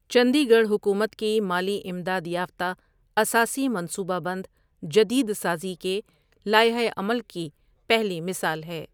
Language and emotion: Urdu, neutral